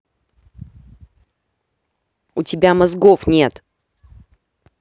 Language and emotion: Russian, angry